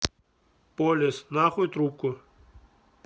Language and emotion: Russian, angry